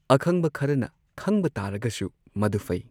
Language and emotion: Manipuri, neutral